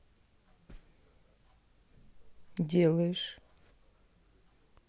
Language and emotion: Russian, neutral